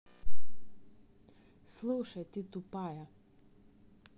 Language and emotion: Russian, neutral